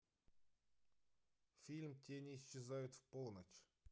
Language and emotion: Russian, neutral